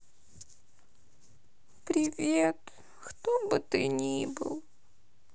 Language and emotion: Russian, sad